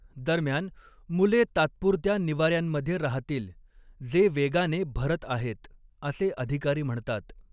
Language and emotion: Marathi, neutral